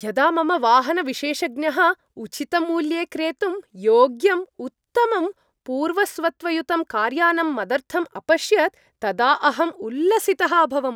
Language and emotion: Sanskrit, happy